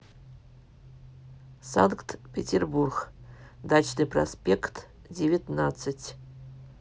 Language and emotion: Russian, neutral